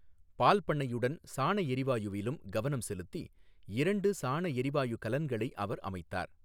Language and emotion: Tamil, neutral